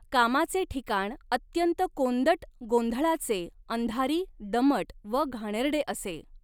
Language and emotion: Marathi, neutral